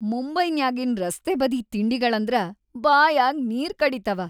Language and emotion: Kannada, happy